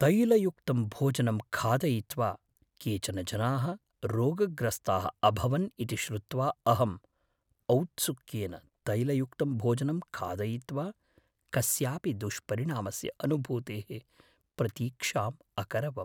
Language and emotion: Sanskrit, fearful